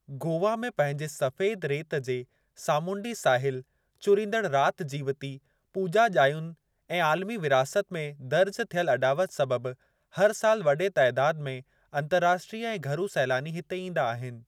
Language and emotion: Sindhi, neutral